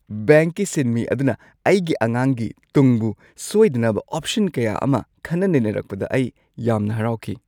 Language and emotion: Manipuri, happy